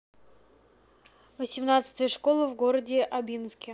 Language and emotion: Russian, neutral